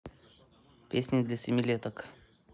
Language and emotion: Russian, neutral